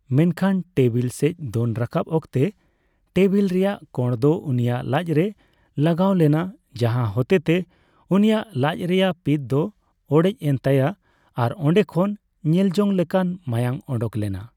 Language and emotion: Santali, neutral